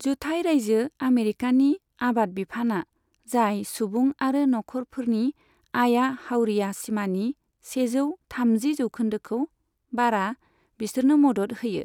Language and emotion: Bodo, neutral